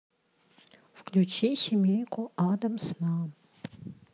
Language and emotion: Russian, neutral